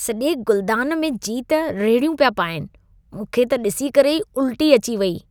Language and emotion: Sindhi, disgusted